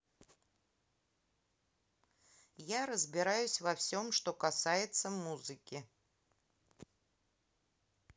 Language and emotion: Russian, neutral